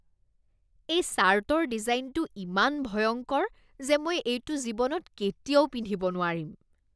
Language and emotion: Assamese, disgusted